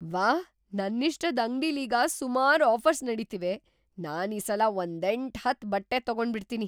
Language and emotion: Kannada, surprised